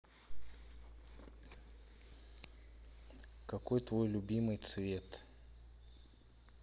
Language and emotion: Russian, neutral